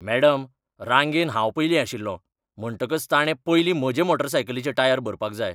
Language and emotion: Goan Konkani, angry